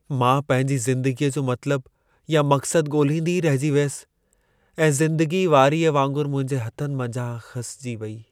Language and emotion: Sindhi, sad